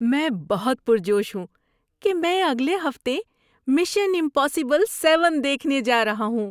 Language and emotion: Urdu, happy